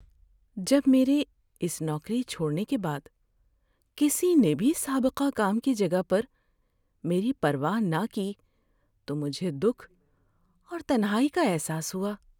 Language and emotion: Urdu, sad